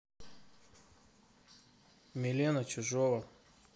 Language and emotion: Russian, neutral